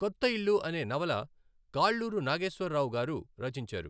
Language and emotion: Telugu, neutral